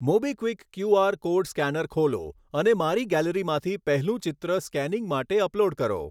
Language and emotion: Gujarati, neutral